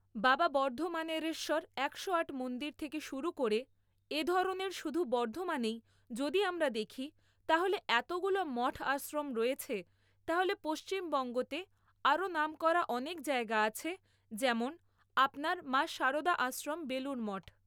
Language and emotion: Bengali, neutral